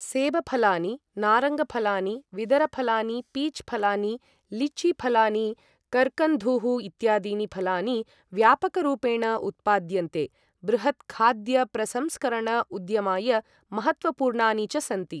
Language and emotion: Sanskrit, neutral